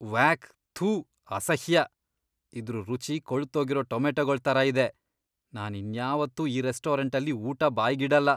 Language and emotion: Kannada, disgusted